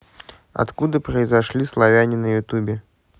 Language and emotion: Russian, neutral